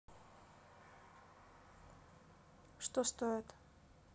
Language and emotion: Russian, neutral